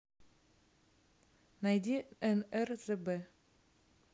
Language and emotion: Russian, neutral